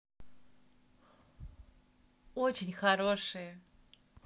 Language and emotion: Russian, positive